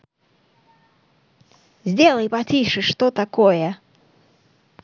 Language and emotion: Russian, angry